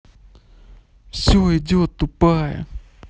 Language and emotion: Russian, neutral